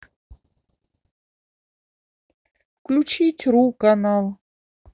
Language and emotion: Russian, neutral